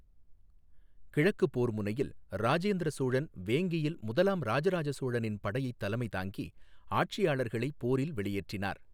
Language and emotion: Tamil, neutral